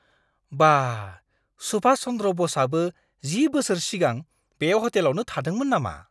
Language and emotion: Bodo, surprised